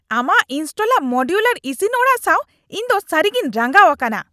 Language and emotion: Santali, angry